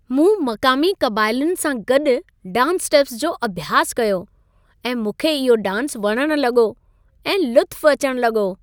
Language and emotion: Sindhi, happy